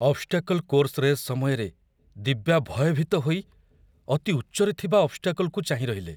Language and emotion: Odia, fearful